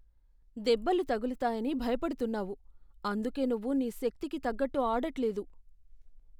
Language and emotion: Telugu, fearful